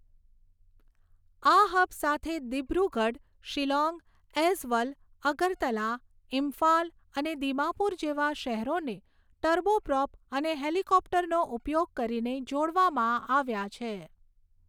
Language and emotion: Gujarati, neutral